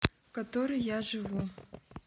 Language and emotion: Russian, neutral